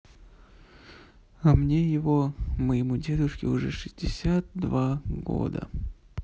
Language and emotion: Russian, sad